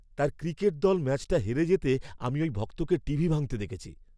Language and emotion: Bengali, angry